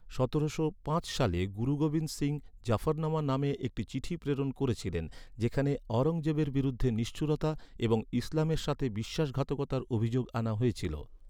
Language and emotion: Bengali, neutral